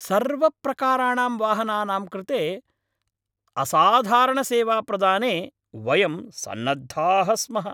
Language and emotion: Sanskrit, happy